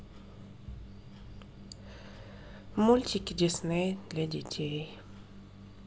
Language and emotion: Russian, sad